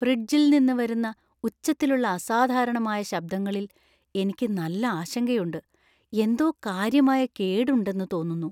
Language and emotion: Malayalam, fearful